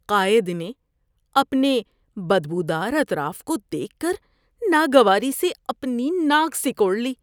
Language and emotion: Urdu, disgusted